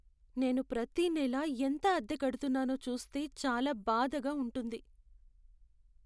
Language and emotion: Telugu, sad